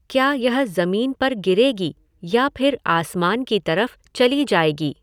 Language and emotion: Hindi, neutral